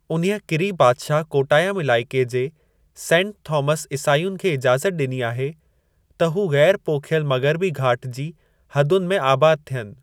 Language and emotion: Sindhi, neutral